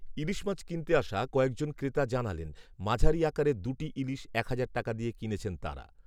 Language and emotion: Bengali, neutral